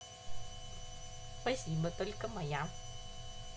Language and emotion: Russian, positive